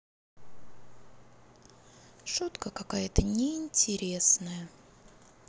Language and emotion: Russian, sad